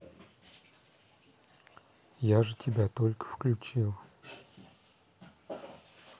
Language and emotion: Russian, neutral